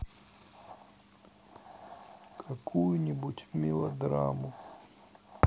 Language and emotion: Russian, sad